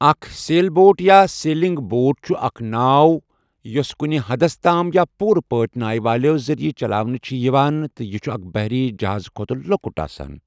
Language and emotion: Kashmiri, neutral